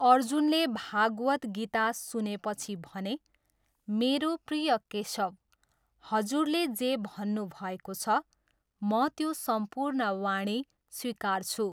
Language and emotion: Nepali, neutral